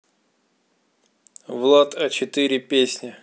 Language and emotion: Russian, neutral